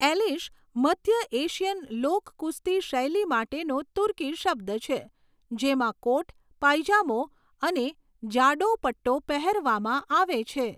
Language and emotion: Gujarati, neutral